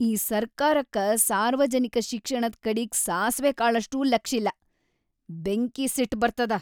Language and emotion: Kannada, angry